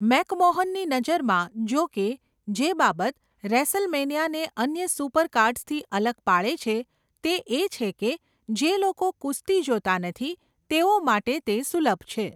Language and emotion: Gujarati, neutral